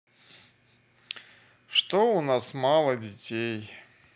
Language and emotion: Russian, sad